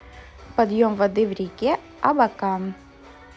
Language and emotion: Russian, neutral